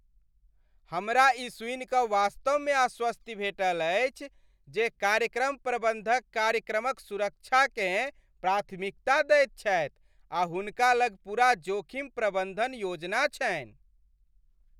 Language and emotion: Maithili, happy